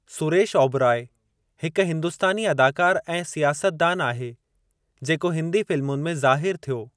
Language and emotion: Sindhi, neutral